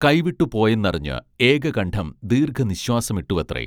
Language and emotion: Malayalam, neutral